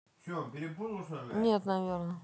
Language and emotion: Russian, neutral